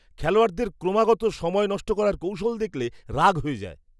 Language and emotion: Bengali, disgusted